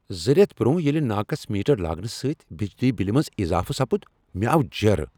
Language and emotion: Kashmiri, angry